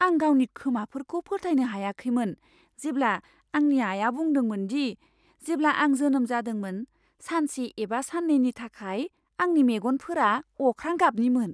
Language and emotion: Bodo, surprised